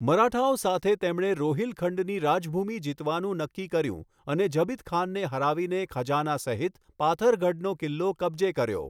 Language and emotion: Gujarati, neutral